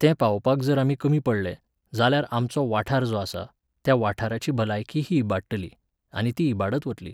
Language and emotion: Goan Konkani, neutral